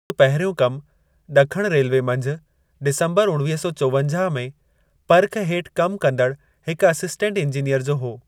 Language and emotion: Sindhi, neutral